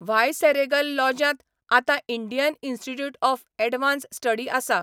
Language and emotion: Goan Konkani, neutral